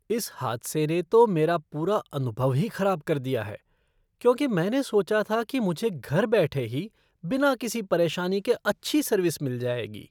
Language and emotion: Hindi, disgusted